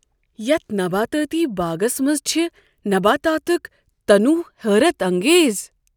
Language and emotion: Kashmiri, surprised